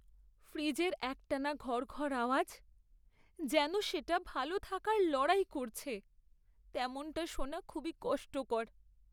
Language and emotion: Bengali, sad